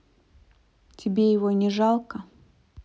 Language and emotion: Russian, neutral